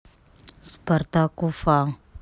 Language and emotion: Russian, neutral